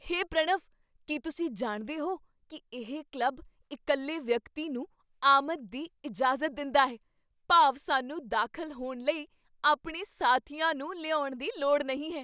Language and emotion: Punjabi, surprised